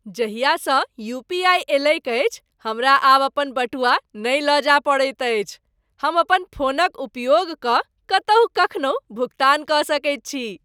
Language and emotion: Maithili, happy